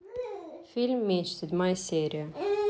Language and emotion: Russian, neutral